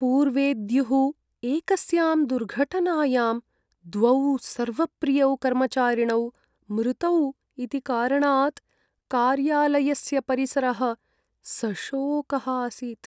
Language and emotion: Sanskrit, sad